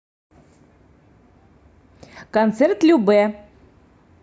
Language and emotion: Russian, positive